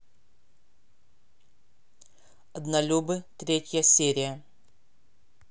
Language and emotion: Russian, neutral